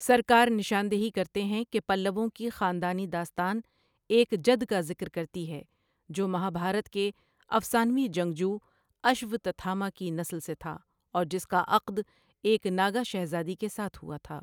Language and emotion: Urdu, neutral